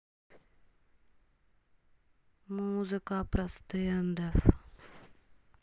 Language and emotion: Russian, sad